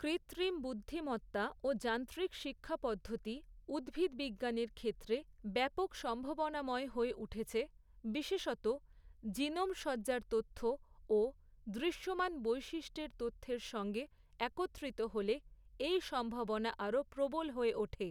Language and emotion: Bengali, neutral